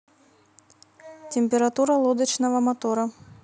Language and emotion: Russian, neutral